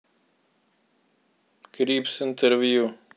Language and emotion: Russian, neutral